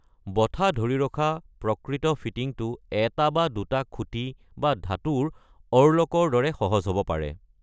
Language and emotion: Assamese, neutral